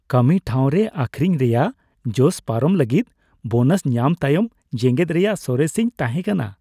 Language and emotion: Santali, happy